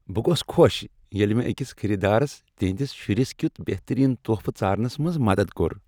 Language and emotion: Kashmiri, happy